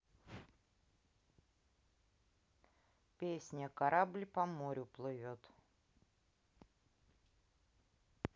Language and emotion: Russian, neutral